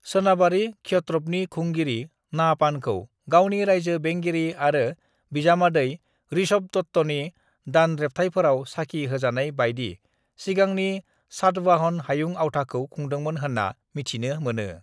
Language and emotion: Bodo, neutral